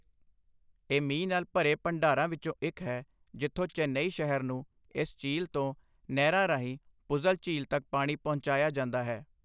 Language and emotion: Punjabi, neutral